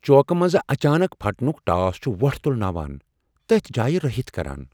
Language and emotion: Kashmiri, fearful